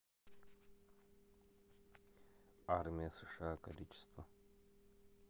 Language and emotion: Russian, neutral